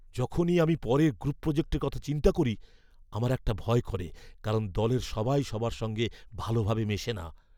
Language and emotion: Bengali, fearful